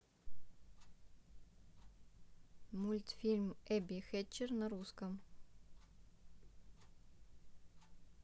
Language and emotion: Russian, neutral